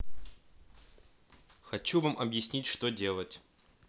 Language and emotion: Russian, neutral